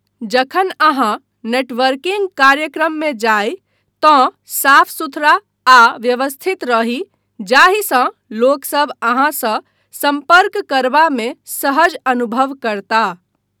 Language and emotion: Maithili, neutral